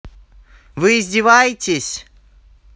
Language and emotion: Russian, angry